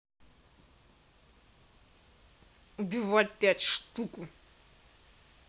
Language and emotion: Russian, angry